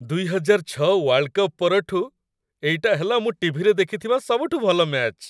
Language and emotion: Odia, happy